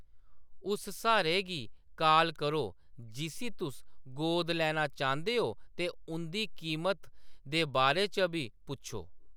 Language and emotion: Dogri, neutral